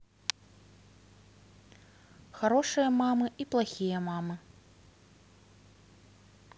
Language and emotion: Russian, neutral